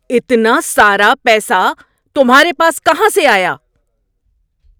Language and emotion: Urdu, angry